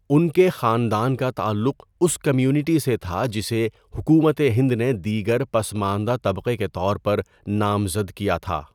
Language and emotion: Urdu, neutral